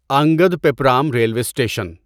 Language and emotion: Urdu, neutral